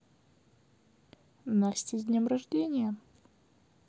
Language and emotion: Russian, positive